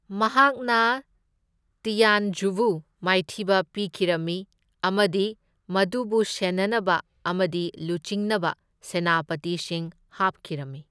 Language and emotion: Manipuri, neutral